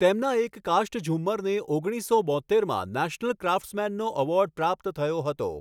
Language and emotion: Gujarati, neutral